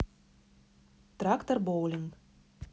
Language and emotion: Russian, neutral